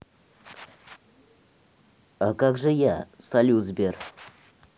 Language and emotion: Russian, neutral